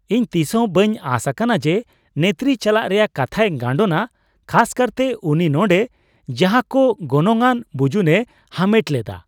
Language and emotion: Santali, surprised